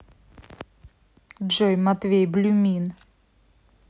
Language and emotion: Russian, angry